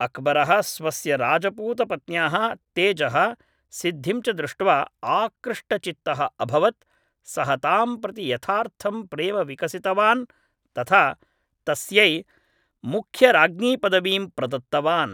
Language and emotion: Sanskrit, neutral